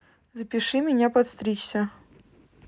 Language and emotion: Russian, neutral